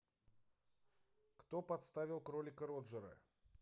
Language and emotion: Russian, neutral